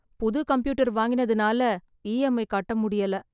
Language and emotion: Tamil, sad